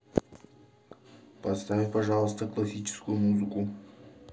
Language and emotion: Russian, neutral